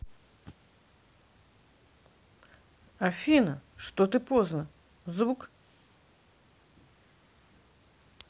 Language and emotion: Russian, neutral